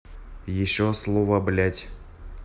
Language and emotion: Russian, neutral